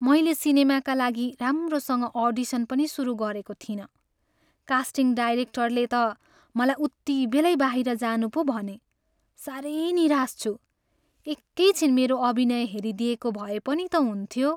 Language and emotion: Nepali, sad